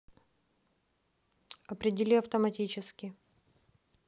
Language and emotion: Russian, neutral